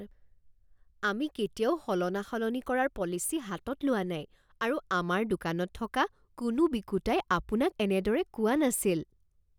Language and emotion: Assamese, surprised